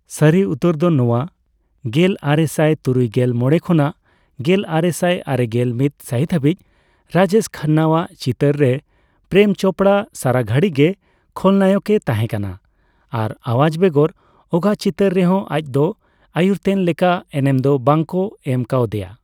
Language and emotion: Santali, neutral